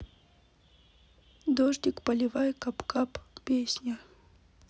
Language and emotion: Russian, sad